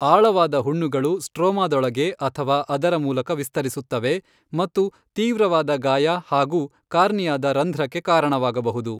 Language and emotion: Kannada, neutral